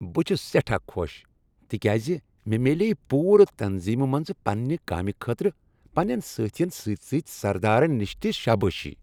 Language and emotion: Kashmiri, happy